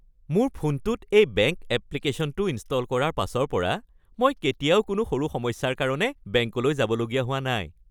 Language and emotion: Assamese, happy